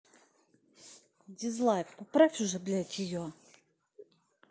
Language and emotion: Russian, angry